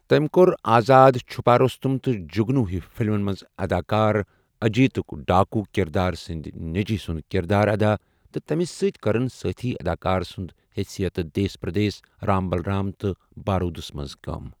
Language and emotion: Kashmiri, neutral